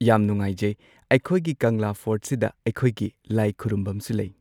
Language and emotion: Manipuri, neutral